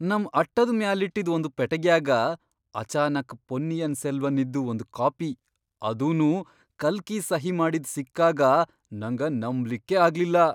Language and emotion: Kannada, surprised